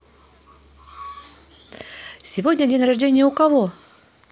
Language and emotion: Russian, neutral